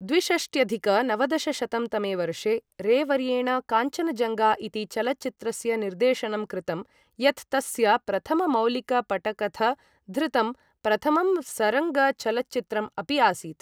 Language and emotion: Sanskrit, neutral